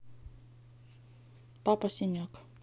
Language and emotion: Russian, neutral